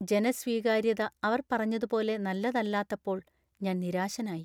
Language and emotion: Malayalam, sad